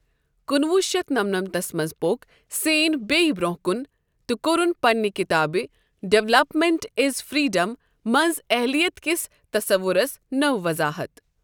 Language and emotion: Kashmiri, neutral